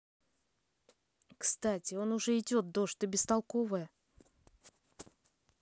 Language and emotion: Russian, angry